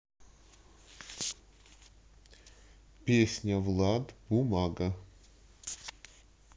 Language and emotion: Russian, neutral